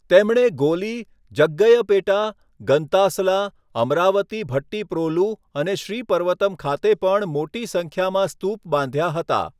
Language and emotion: Gujarati, neutral